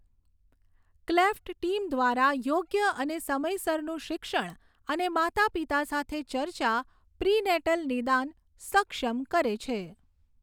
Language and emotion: Gujarati, neutral